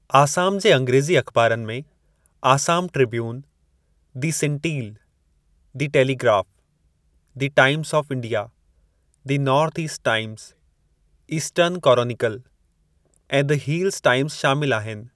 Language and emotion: Sindhi, neutral